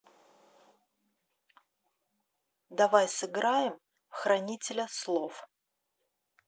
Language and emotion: Russian, neutral